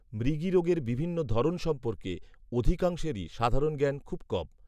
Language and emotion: Bengali, neutral